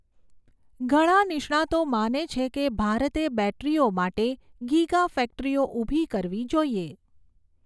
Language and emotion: Gujarati, neutral